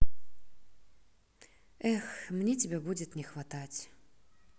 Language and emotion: Russian, sad